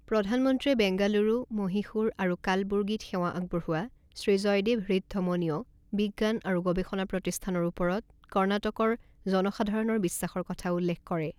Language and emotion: Assamese, neutral